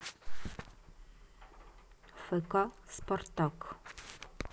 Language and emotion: Russian, neutral